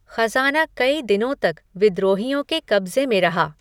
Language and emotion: Hindi, neutral